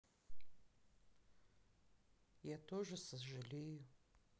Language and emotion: Russian, sad